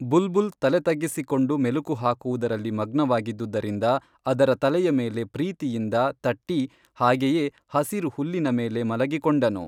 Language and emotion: Kannada, neutral